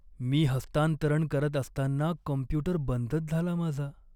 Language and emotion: Marathi, sad